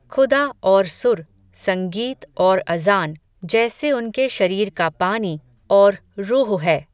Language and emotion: Hindi, neutral